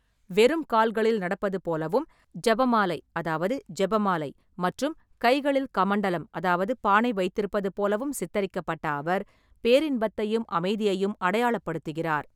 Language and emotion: Tamil, neutral